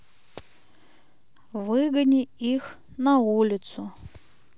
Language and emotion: Russian, sad